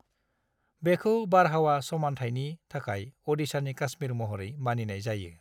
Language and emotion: Bodo, neutral